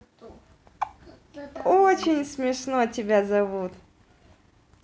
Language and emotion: Russian, positive